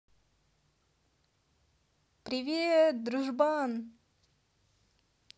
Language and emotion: Russian, positive